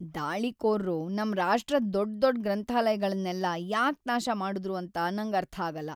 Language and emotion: Kannada, sad